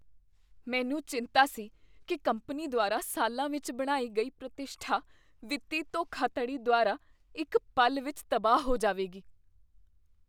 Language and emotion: Punjabi, fearful